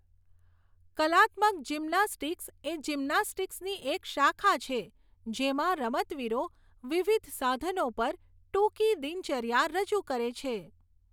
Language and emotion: Gujarati, neutral